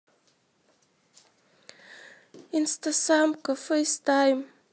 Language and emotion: Russian, sad